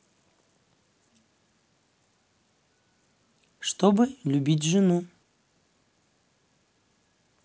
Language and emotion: Russian, neutral